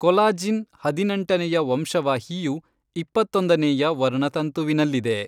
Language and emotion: Kannada, neutral